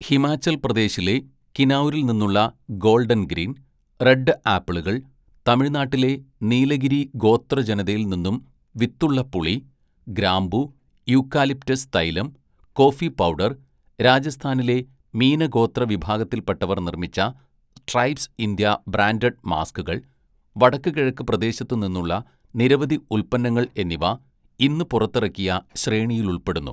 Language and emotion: Malayalam, neutral